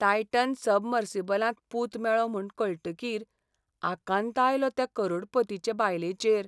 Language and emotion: Goan Konkani, sad